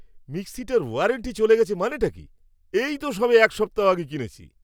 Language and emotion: Bengali, angry